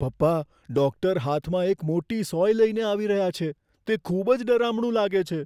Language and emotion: Gujarati, fearful